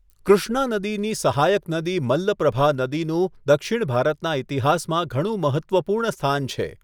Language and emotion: Gujarati, neutral